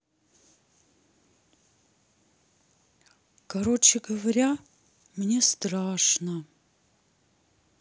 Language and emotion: Russian, sad